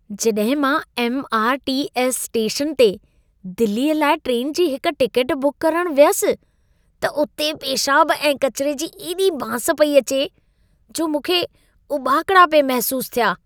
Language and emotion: Sindhi, disgusted